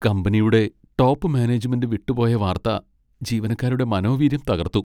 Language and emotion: Malayalam, sad